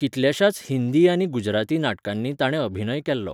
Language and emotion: Goan Konkani, neutral